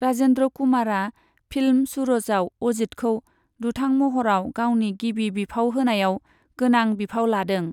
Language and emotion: Bodo, neutral